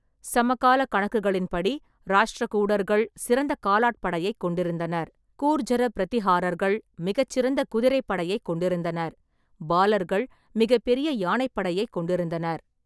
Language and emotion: Tamil, neutral